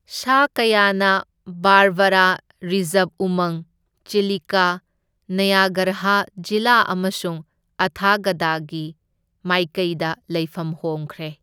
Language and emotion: Manipuri, neutral